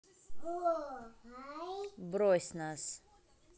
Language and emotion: Russian, neutral